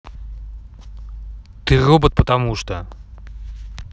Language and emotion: Russian, neutral